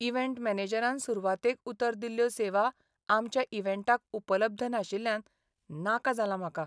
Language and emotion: Goan Konkani, sad